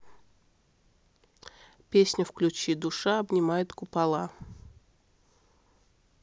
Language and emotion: Russian, neutral